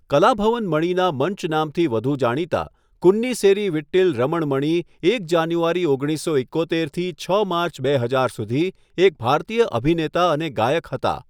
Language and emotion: Gujarati, neutral